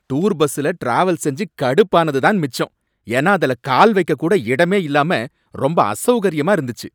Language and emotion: Tamil, angry